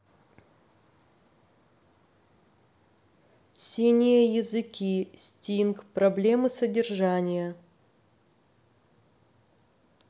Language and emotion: Russian, neutral